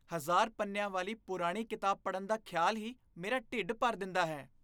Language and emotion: Punjabi, disgusted